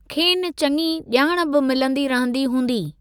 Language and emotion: Sindhi, neutral